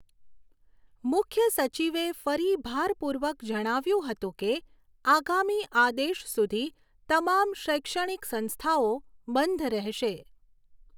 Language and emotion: Gujarati, neutral